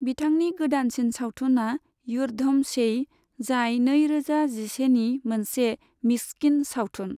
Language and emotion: Bodo, neutral